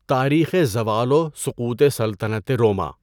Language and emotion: Urdu, neutral